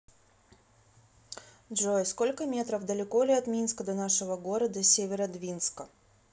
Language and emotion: Russian, neutral